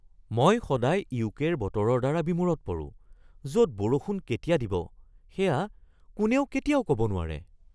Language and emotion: Assamese, surprised